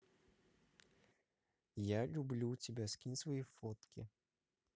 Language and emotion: Russian, positive